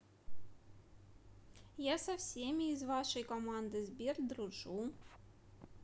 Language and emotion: Russian, neutral